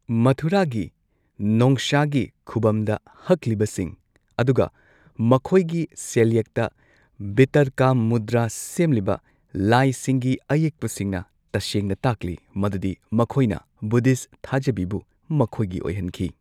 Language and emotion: Manipuri, neutral